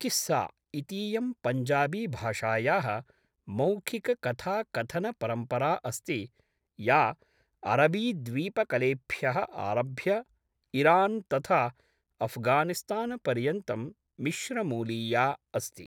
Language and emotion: Sanskrit, neutral